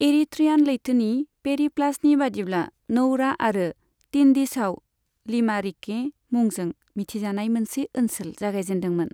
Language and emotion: Bodo, neutral